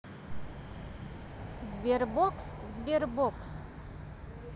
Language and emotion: Russian, neutral